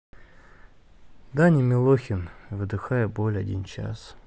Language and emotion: Russian, sad